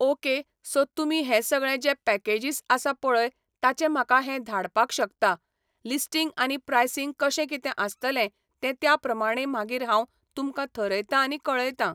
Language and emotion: Goan Konkani, neutral